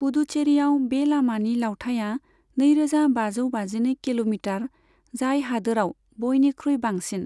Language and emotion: Bodo, neutral